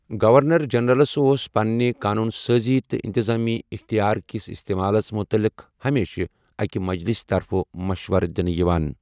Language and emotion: Kashmiri, neutral